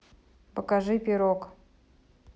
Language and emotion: Russian, neutral